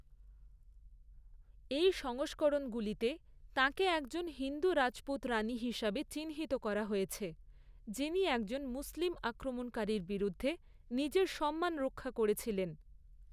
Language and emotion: Bengali, neutral